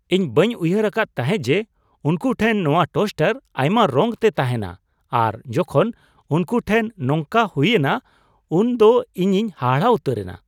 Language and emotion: Santali, surprised